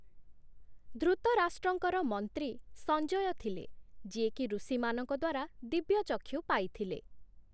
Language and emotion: Odia, neutral